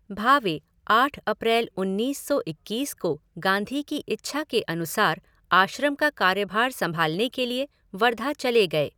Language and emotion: Hindi, neutral